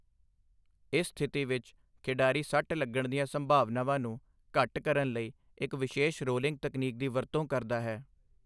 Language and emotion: Punjabi, neutral